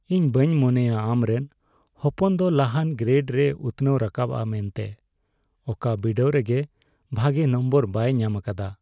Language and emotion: Santali, sad